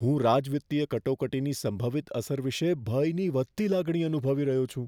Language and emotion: Gujarati, fearful